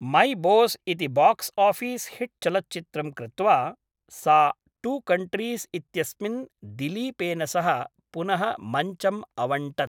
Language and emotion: Sanskrit, neutral